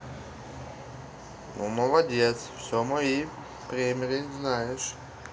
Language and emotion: Russian, positive